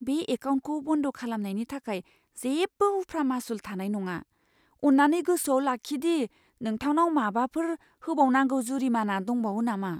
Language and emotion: Bodo, fearful